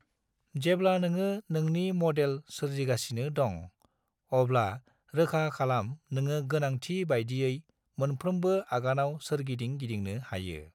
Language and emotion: Bodo, neutral